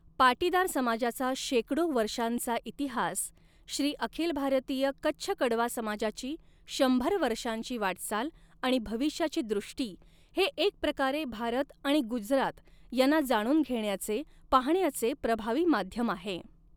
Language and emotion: Marathi, neutral